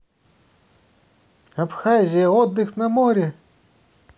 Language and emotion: Russian, positive